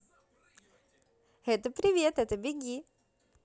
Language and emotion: Russian, positive